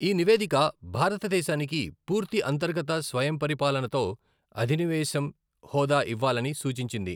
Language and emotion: Telugu, neutral